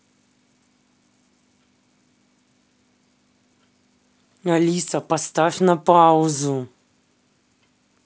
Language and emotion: Russian, angry